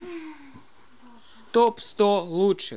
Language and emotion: Russian, neutral